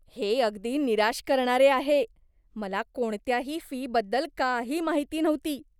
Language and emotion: Marathi, disgusted